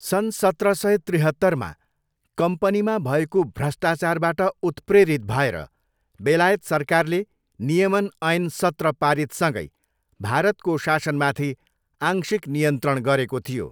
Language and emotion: Nepali, neutral